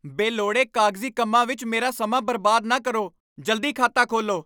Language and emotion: Punjabi, angry